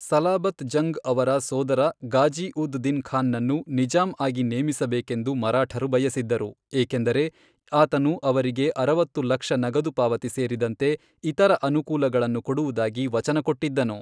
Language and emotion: Kannada, neutral